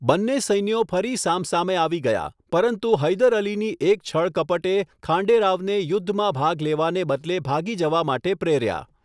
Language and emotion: Gujarati, neutral